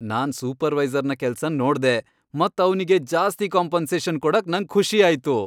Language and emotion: Kannada, happy